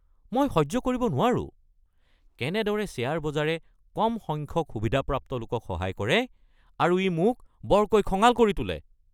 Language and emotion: Assamese, angry